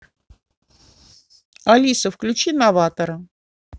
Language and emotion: Russian, neutral